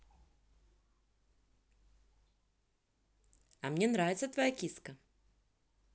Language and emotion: Russian, positive